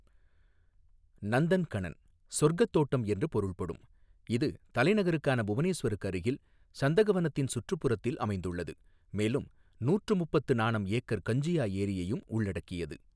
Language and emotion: Tamil, neutral